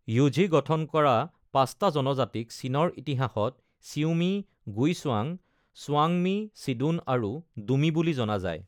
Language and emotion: Assamese, neutral